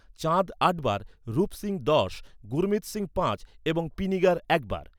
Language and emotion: Bengali, neutral